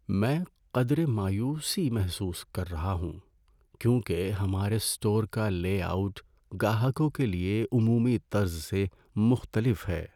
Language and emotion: Urdu, sad